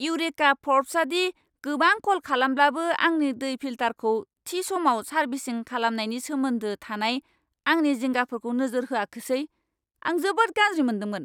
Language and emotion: Bodo, angry